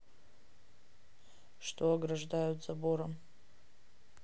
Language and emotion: Russian, neutral